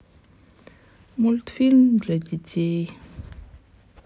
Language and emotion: Russian, sad